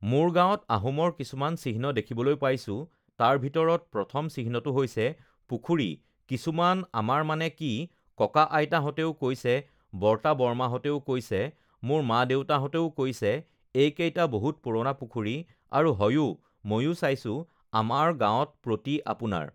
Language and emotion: Assamese, neutral